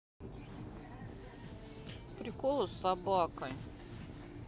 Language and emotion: Russian, neutral